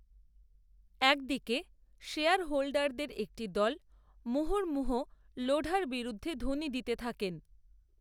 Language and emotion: Bengali, neutral